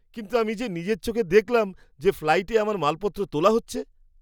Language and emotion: Bengali, surprised